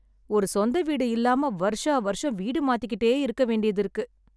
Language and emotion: Tamil, sad